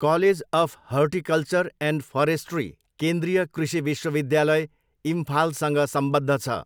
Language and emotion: Nepali, neutral